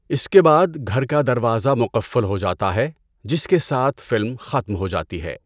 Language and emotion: Urdu, neutral